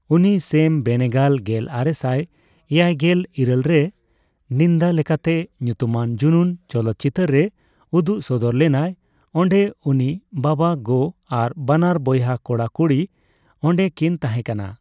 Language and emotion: Santali, neutral